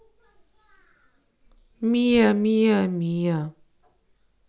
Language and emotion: Russian, neutral